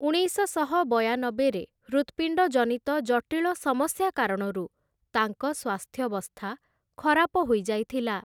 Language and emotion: Odia, neutral